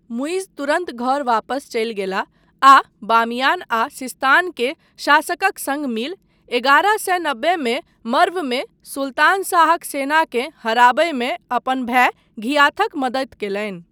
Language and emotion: Maithili, neutral